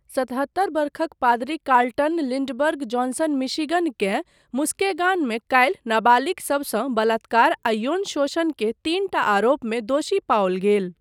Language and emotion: Maithili, neutral